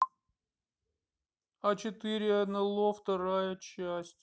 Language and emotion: Russian, sad